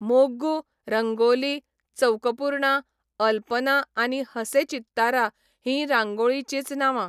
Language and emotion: Goan Konkani, neutral